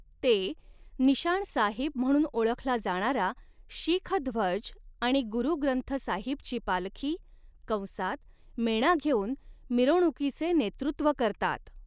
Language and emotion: Marathi, neutral